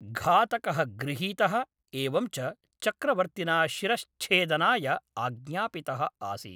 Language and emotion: Sanskrit, neutral